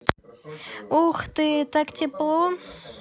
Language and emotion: Russian, positive